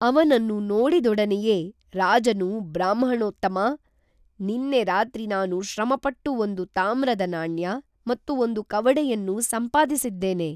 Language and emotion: Kannada, neutral